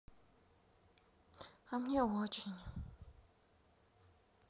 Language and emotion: Russian, sad